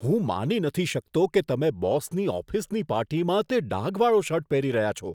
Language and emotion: Gujarati, disgusted